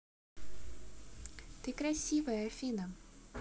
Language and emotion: Russian, positive